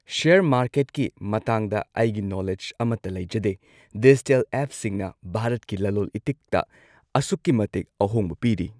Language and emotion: Manipuri, neutral